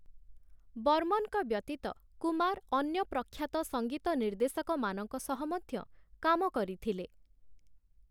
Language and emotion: Odia, neutral